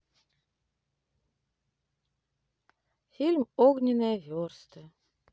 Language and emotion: Russian, sad